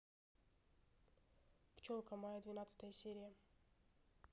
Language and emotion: Russian, neutral